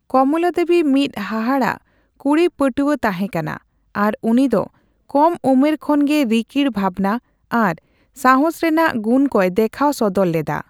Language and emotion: Santali, neutral